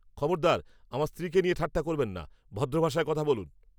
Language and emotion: Bengali, angry